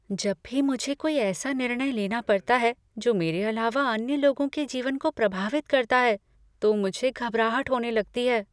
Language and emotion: Hindi, fearful